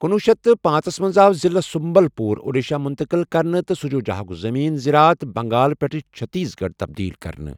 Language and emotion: Kashmiri, neutral